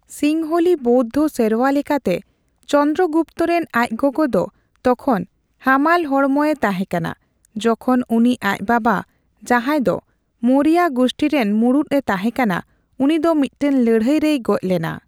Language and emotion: Santali, neutral